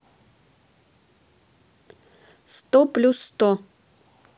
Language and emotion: Russian, neutral